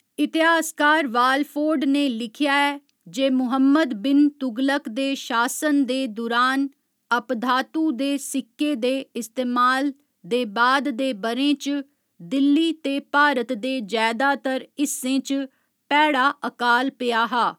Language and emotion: Dogri, neutral